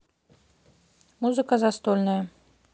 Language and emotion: Russian, neutral